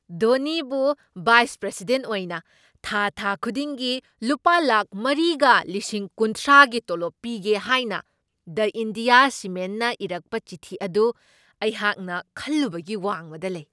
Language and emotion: Manipuri, surprised